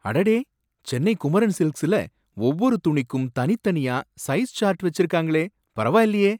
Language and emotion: Tamil, surprised